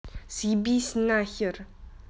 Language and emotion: Russian, angry